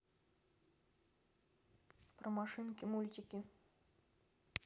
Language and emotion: Russian, neutral